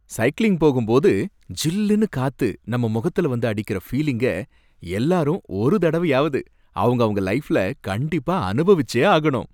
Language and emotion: Tamil, happy